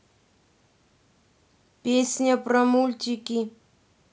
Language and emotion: Russian, neutral